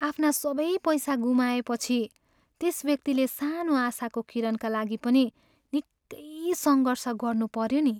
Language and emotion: Nepali, sad